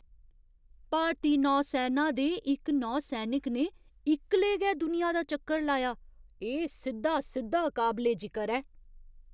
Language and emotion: Dogri, surprised